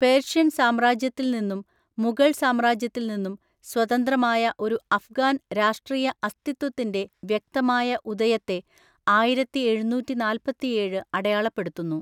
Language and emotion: Malayalam, neutral